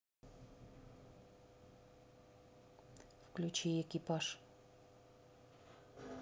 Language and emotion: Russian, neutral